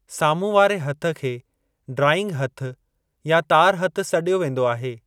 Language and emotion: Sindhi, neutral